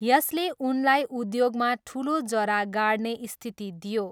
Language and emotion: Nepali, neutral